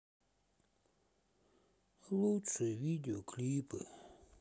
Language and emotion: Russian, sad